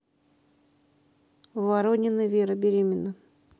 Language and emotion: Russian, neutral